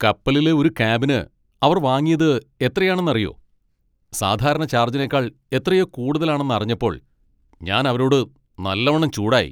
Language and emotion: Malayalam, angry